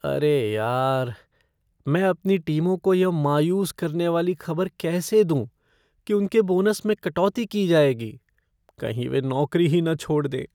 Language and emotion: Hindi, fearful